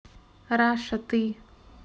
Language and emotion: Russian, neutral